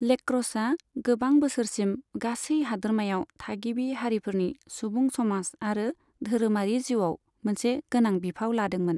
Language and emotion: Bodo, neutral